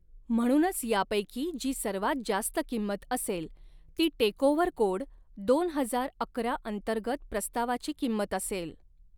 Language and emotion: Marathi, neutral